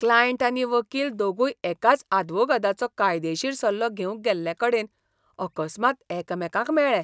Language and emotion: Goan Konkani, disgusted